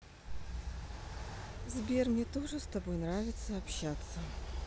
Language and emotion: Russian, neutral